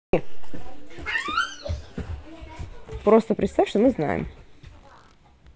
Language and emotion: Russian, positive